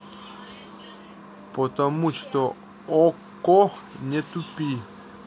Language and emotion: Russian, neutral